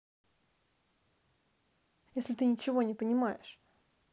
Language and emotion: Russian, angry